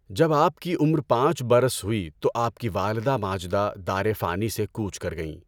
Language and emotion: Urdu, neutral